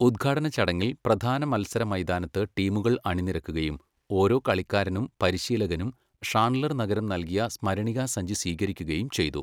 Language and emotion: Malayalam, neutral